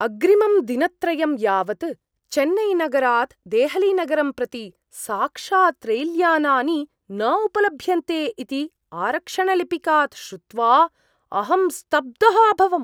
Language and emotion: Sanskrit, surprised